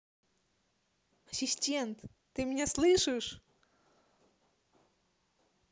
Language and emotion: Russian, positive